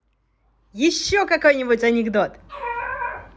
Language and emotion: Russian, positive